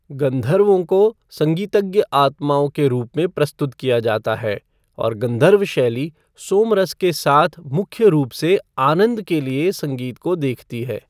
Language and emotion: Hindi, neutral